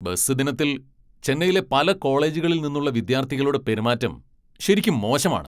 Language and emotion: Malayalam, angry